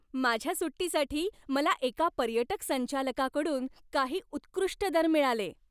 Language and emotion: Marathi, happy